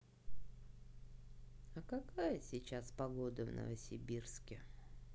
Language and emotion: Russian, neutral